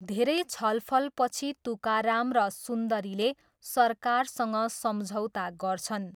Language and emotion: Nepali, neutral